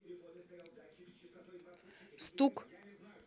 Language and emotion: Russian, neutral